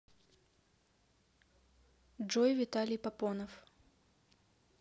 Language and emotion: Russian, neutral